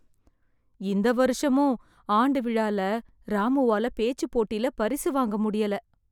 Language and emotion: Tamil, sad